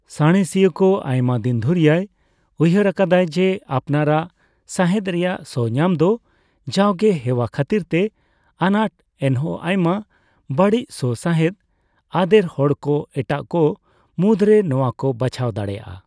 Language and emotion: Santali, neutral